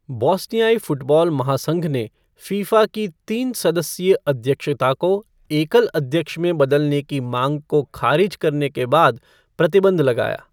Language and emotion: Hindi, neutral